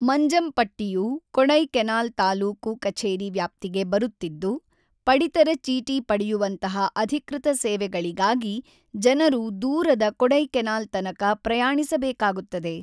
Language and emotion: Kannada, neutral